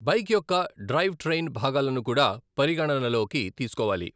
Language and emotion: Telugu, neutral